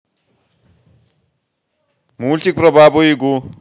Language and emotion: Russian, positive